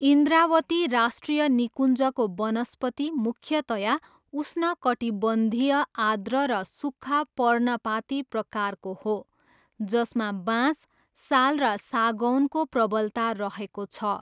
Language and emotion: Nepali, neutral